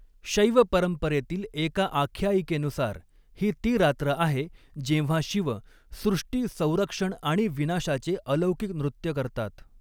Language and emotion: Marathi, neutral